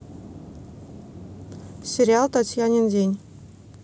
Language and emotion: Russian, neutral